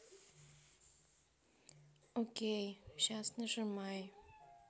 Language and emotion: Russian, neutral